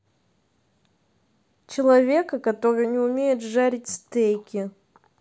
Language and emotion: Russian, neutral